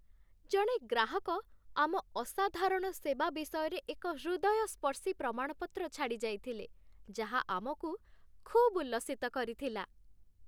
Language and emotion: Odia, happy